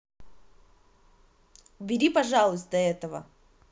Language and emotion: Russian, angry